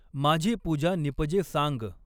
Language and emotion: Marathi, neutral